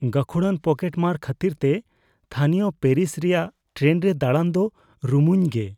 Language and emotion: Santali, fearful